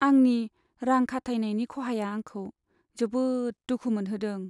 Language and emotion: Bodo, sad